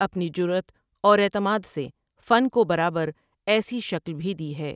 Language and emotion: Urdu, neutral